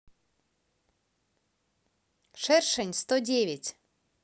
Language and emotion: Russian, positive